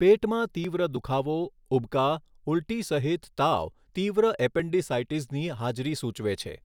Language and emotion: Gujarati, neutral